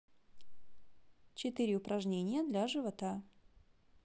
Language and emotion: Russian, neutral